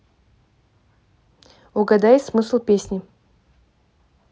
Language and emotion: Russian, neutral